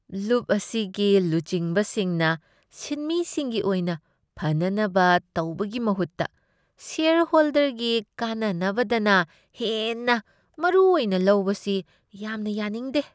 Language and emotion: Manipuri, disgusted